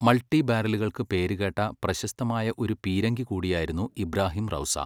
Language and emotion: Malayalam, neutral